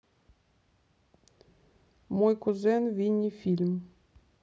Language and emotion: Russian, neutral